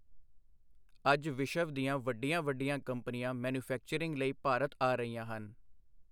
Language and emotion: Punjabi, neutral